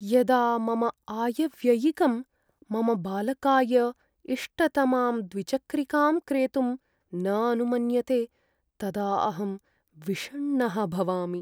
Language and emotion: Sanskrit, sad